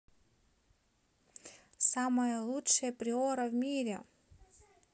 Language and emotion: Russian, positive